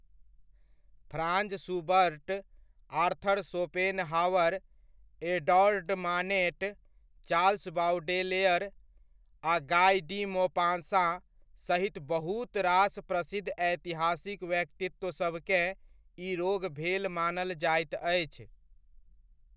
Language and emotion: Maithili, neutral